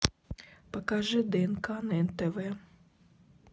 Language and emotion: Russian, neutral